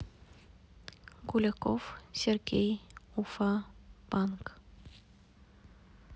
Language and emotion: Russian, neutral